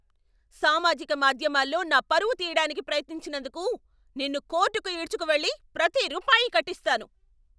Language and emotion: Telugu, angry